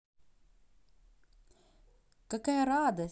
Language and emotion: Russian, positive